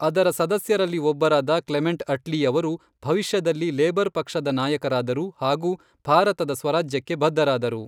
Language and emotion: Kannada, neutral